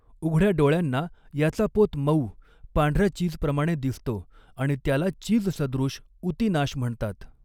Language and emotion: Marathi, neutral